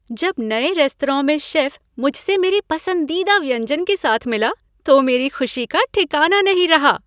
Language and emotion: Hindi, happy